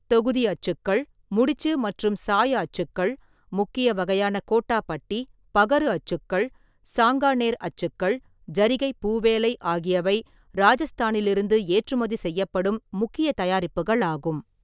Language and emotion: Tamil, neutral